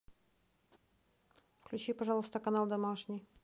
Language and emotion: Russian, neutral